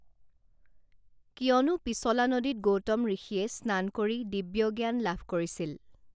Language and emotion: Assamese, neutral